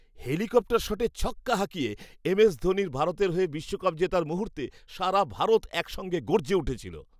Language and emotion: Bengali, happy